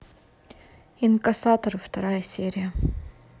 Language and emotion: Russian, neutral